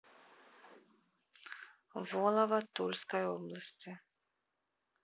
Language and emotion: Russian, neutral